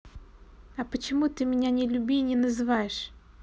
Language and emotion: Russian, neutral